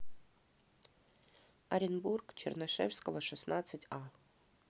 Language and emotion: Russian, neutral